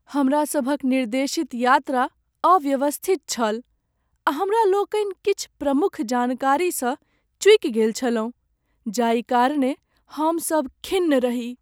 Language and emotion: Maithili, sad